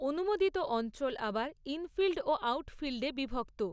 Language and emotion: Bengali, neutral